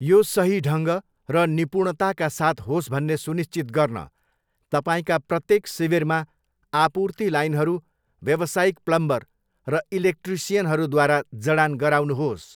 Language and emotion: Nepali, neutral